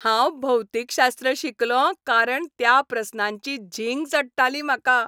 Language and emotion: Goan Konkani, happy